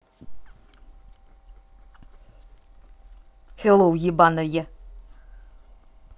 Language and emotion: Russian, angry